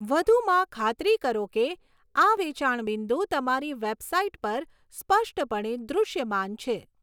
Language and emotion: Gujarati, neutral